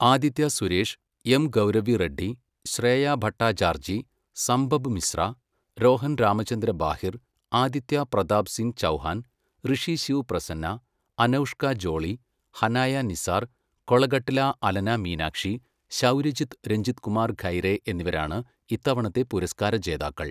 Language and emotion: Malayalam, neutral